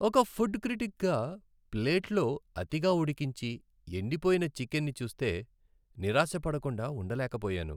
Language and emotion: Telugu, sad